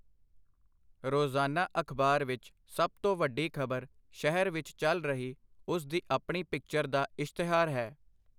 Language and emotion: Punjabi, neutral